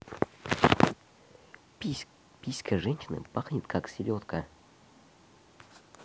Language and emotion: Russian, neutral